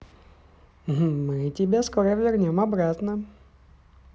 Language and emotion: Russian, positive